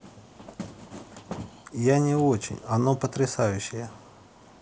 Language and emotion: Russian, neutral